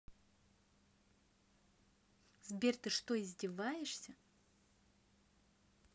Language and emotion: Russian, angry